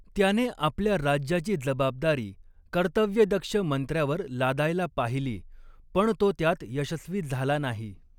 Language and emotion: Marathi, neutral